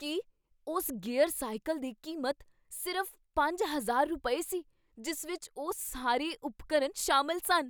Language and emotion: Punjabi, surprised